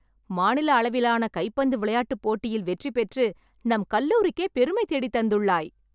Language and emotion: Tamil, happy